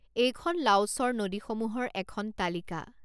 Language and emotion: Assamese, neutral